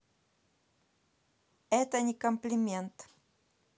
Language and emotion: Russian, neutral